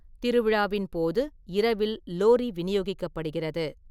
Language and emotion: Tamil, neutral